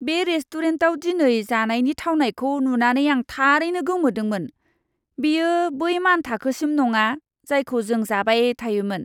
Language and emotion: Bodo, disgusted